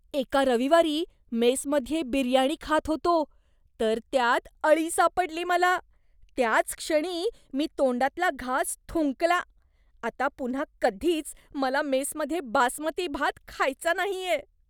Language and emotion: Marathi, disgusted